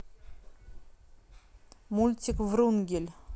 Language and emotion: Russian, neutral